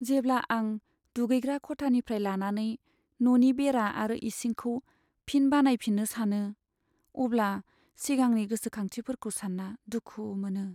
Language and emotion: Bodo, sad